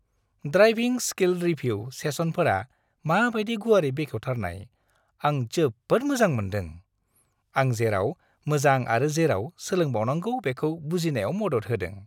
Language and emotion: Bodo, happy